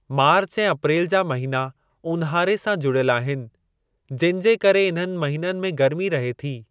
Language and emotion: Sindhi, neutral